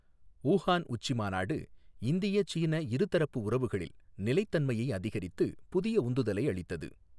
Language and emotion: Tamil, neutral